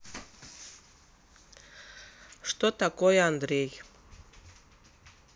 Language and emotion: Russian, neutral